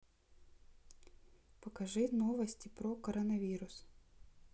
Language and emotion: Russian, neutral